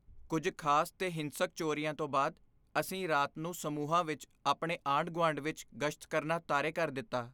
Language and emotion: Punjabi, fearful